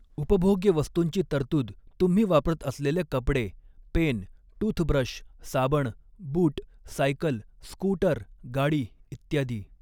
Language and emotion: Marathi, neutral